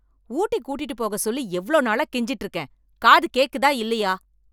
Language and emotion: Tamil, angry